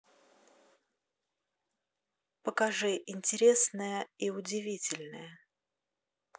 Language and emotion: Russian, neutral